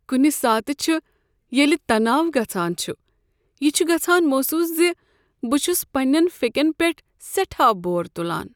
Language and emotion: Kashmiri, sad